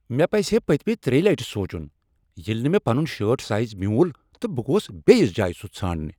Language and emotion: Kashmiri, angry